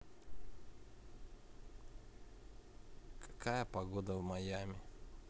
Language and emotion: Russian, neutral